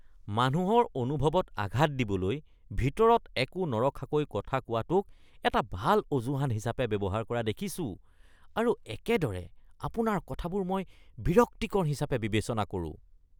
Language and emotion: Assamese, disgusted